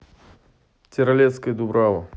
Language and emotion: Russian, neutral